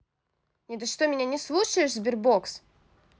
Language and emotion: Russian, angry